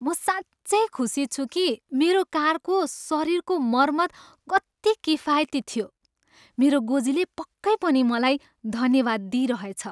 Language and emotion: Nepali, happy